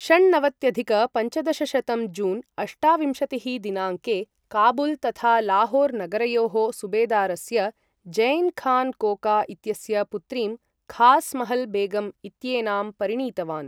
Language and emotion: Sanskrit, neutral